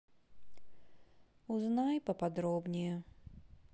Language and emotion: Russian, sad